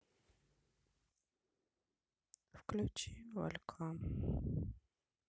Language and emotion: Russian, sad